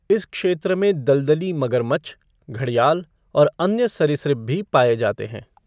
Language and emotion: Hindi, neutral